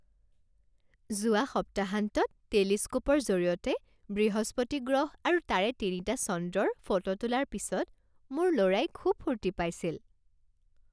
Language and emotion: Assamese, happy